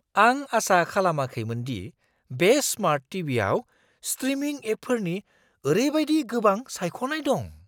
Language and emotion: Bodo, surprised